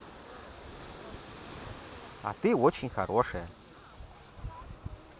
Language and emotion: Russian, positive